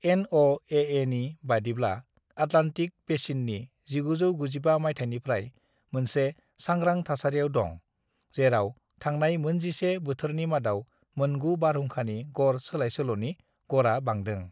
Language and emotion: Bodo, neutral